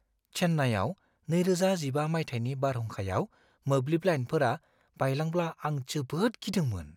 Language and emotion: Bodo, fearful